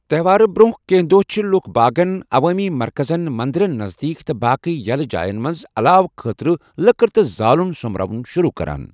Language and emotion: Kashmiri, neutral